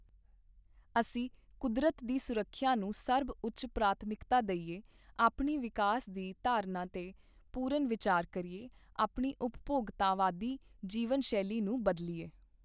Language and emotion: Punjabi, neutral